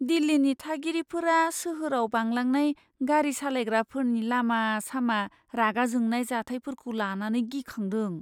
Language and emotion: Bodo, fearful